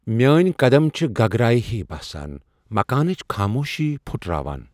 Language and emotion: Kashmiri, fearful